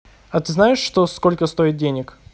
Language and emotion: Russian, neutral